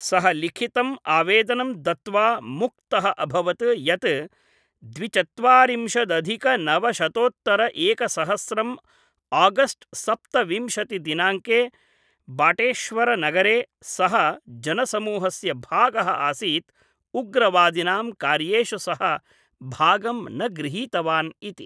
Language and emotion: Sanskrit, neutral